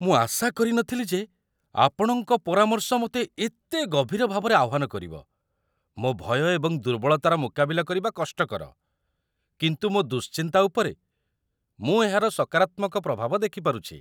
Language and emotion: Odia, surprised